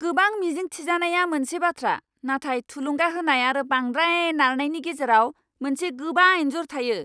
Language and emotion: Bodo, angry